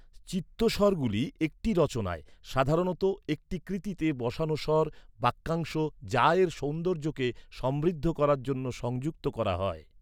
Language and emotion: Bengali, neutral